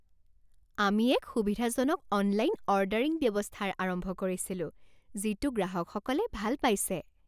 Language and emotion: Assamese, happy